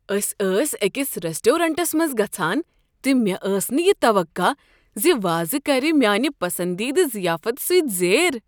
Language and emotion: Kashmiri, surprised